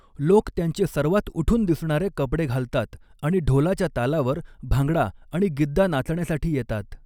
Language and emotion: Marathi, neutral